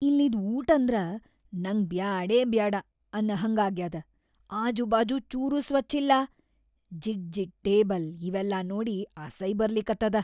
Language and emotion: Kannada, disgusted